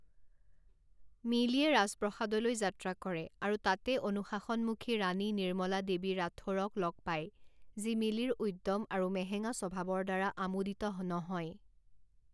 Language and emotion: Assamese, neutral